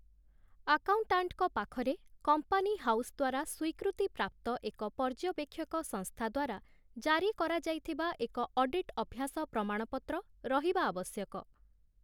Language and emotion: Odia, neutral